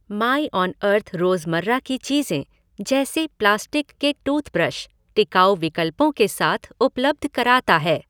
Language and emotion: Hindi, neutral